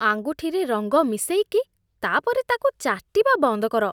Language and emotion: Odia, disgusted